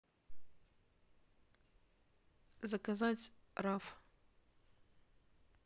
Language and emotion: Russian, neutral